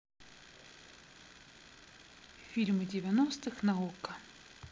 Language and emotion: Russian, neutral